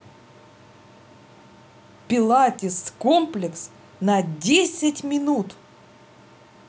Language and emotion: Russian, positive